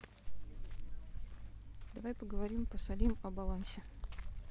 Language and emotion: Russian, neutral